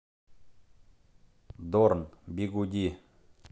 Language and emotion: Russian, neutral